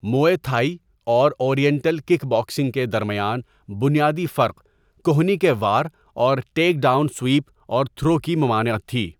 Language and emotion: Urdu, neutral